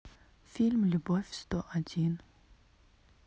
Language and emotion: Russian, sad